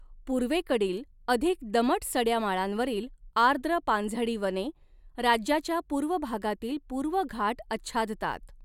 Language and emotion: Marathi, neutral